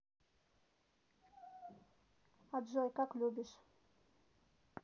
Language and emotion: Russian, neutral